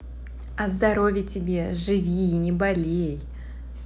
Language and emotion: Russian, positive